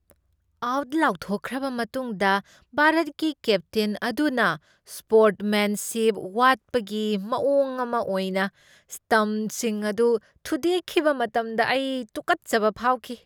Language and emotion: Manipuri, disgusted